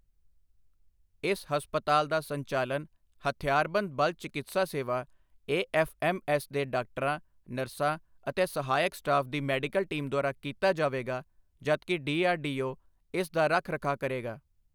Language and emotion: Punjabi, neutral